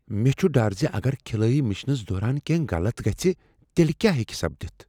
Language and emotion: Kashmiri, fearful